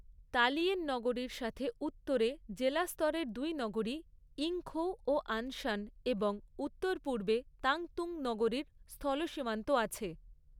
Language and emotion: Bengali, neutral